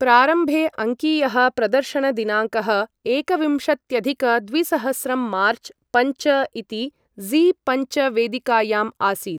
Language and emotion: Sanskrit, neutral